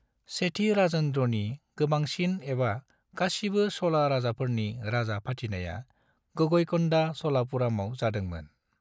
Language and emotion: Bodo, neutral